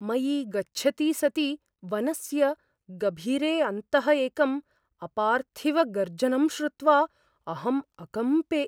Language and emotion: Sanskrit, fearful